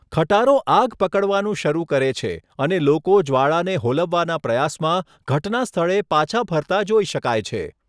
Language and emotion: Gujarati, neutral